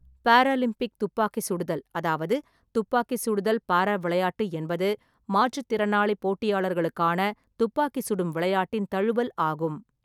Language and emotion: Tamil, neutral